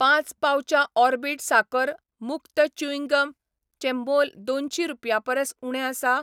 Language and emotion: Goan Konkani, neutral